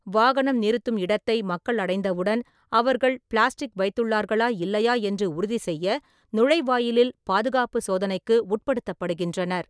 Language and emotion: Tamil, neutral